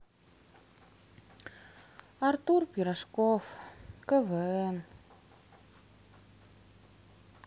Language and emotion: Russian, sad